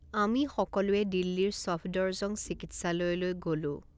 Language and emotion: Assamese, neutral